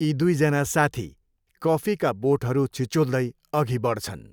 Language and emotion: Nepali, neutral